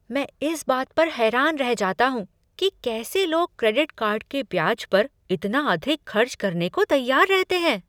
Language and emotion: Hindi, surprised